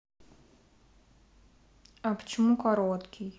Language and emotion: Russian, neutral